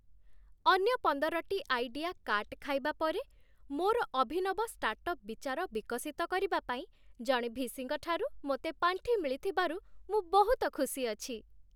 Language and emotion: Odia, happy